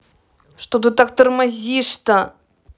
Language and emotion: Russian, angry